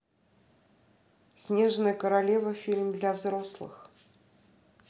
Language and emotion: Russian, neutral